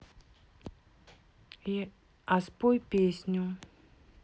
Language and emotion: Russian, neutral